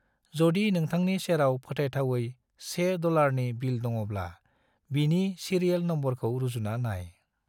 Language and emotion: Bodo, neutral